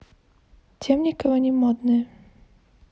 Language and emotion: Russian, neutral